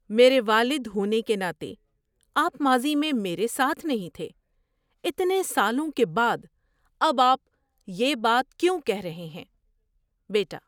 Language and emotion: Urdu, surprised